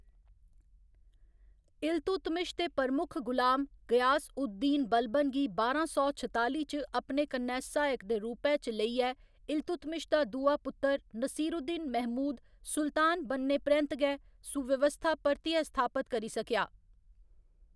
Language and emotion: Dogri, neutral